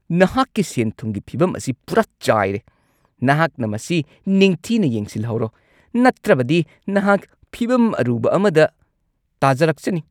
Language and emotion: Manipuri, angry